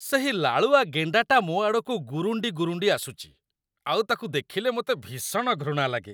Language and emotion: Odia, disgusted